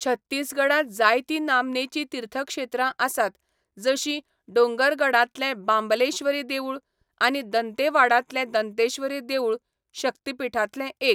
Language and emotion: Goan Konkani, neutral